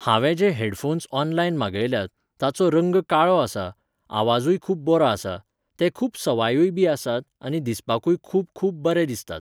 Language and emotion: Goan Konkani, neutral